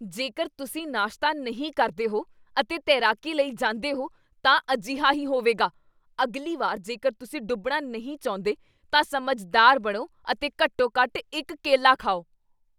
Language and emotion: Punjabi, angry